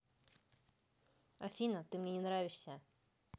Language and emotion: Russian, neutral